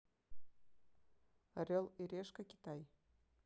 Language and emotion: Russian, neutral